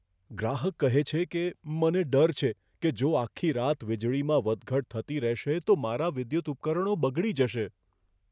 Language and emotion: Gujarati, fearful